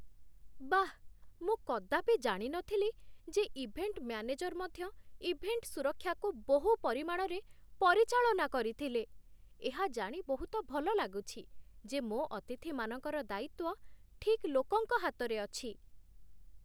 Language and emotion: Odia, surprised